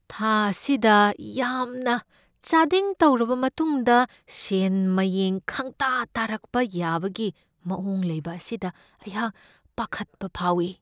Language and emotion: Manipuri, fearful